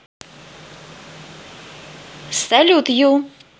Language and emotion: Russian, positive